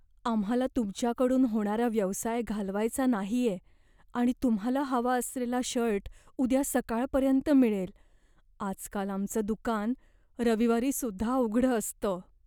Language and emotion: Marathi, fearful